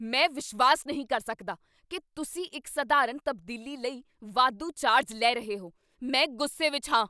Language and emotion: Punjabi, angry